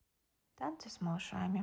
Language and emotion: Russian, neutral